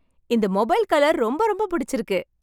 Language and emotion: Tamil, happy